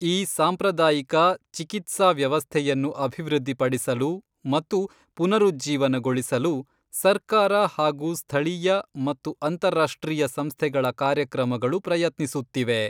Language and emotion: Kannada, neutral